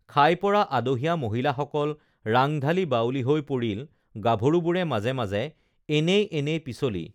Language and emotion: Assamese, neutral